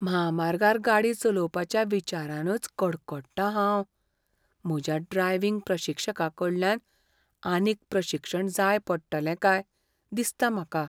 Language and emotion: Goan Konkani, fearful